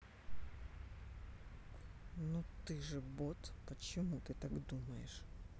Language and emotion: Russian, neutral